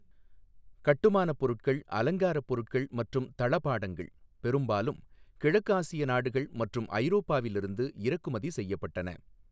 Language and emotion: Tamil, neutral